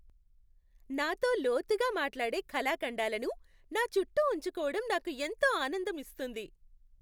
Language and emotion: Telugu, happy